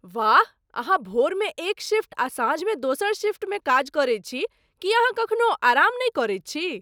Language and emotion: Maithili, surprised